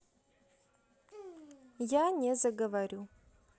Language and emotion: Russian, neutral